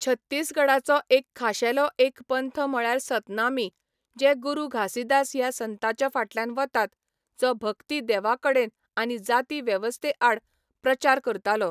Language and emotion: Goan Konkani, neutral